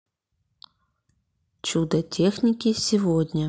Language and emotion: Russian, neutral